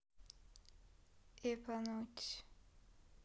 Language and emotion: Russian, sad